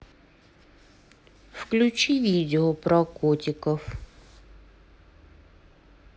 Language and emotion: Russian, neutral